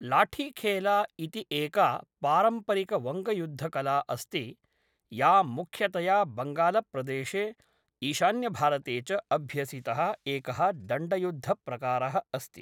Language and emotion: Sanskrit, neutral